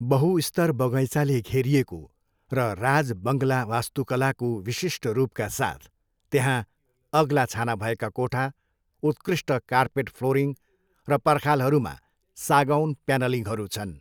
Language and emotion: Nepali, neutral